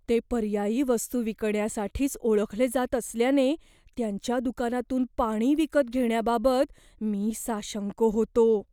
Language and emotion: Marathi, fearful